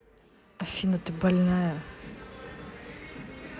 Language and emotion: Russian, angry